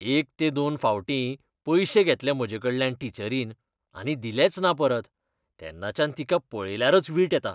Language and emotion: Goan Konkani, disgusted